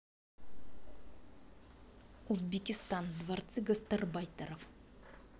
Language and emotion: Russian, angry